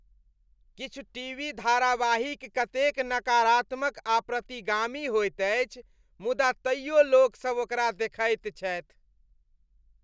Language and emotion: Maithili, disgusted